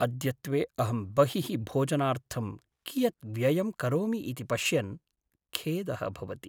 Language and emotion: Sanskrit, sad